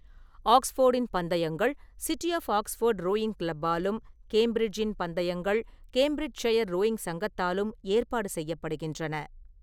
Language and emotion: Tamil, neutral